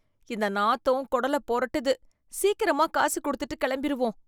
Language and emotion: Tamil, disgusted